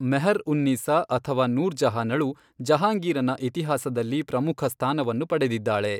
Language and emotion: Kannada, neutral